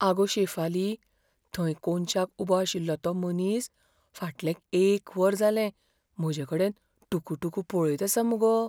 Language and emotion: Goan Konkani, fearful